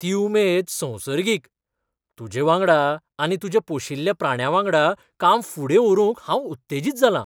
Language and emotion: Goan Konkani, surprised